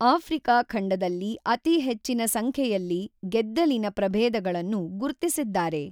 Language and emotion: Kannada, neutral